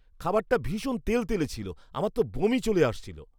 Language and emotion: Bengali, disgusted